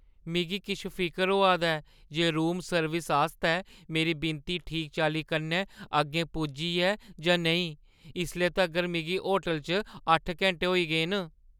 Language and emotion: Dogri, fearful